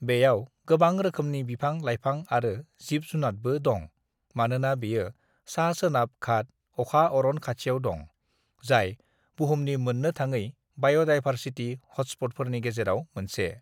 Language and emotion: Bodo, neutral